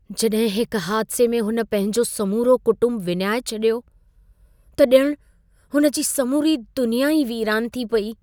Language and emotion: Sindhi, sad